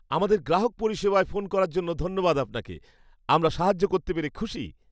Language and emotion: Bengali, happy